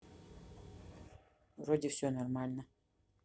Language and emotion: Russian, neutral